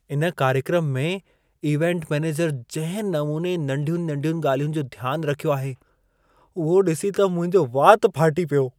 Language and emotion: Sindhi, surprised